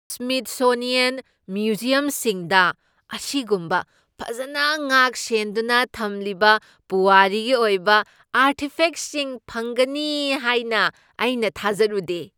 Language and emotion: Manipuri, surprised